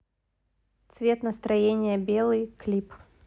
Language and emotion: Russian, neutral